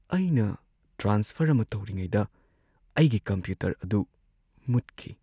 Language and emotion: Manipuri, sad